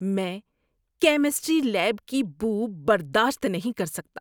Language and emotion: Urdu, disgusted